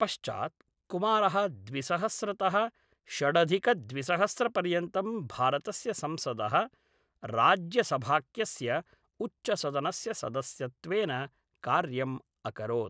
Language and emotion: Sanskrit, neutral